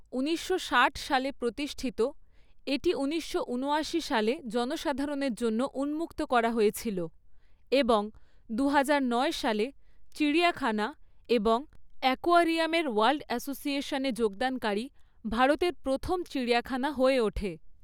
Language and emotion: Bengali, neutral